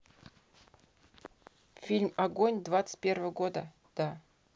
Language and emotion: Russian, neutral